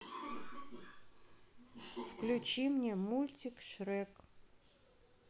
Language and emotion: Russian, neutral